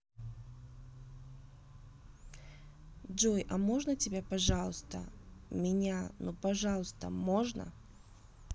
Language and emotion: Russian, neutral